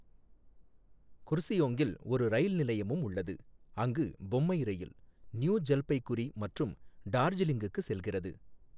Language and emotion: Tamil, neutral